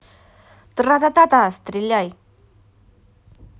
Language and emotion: Russian, neutral